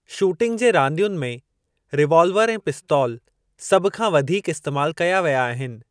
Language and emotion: Sindhi, neutral